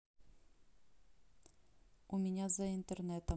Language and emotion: Russian, neutral